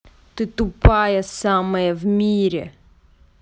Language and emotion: Russian, angry